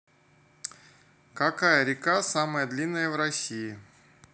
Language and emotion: Russian, neutral